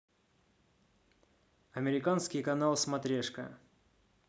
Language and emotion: Russian, neutral